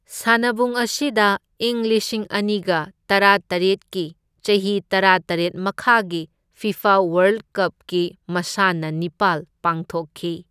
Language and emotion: Manipuri, neutral